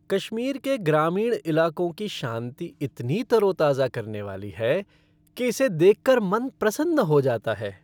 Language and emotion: Hindi, happy